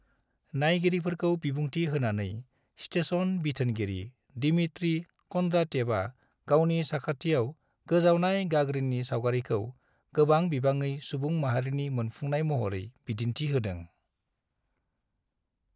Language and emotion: Bodo, neutral